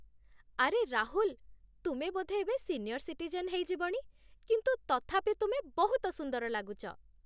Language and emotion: Odia, happy